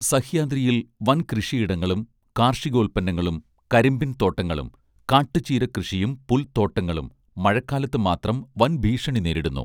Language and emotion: Malayalam, neutral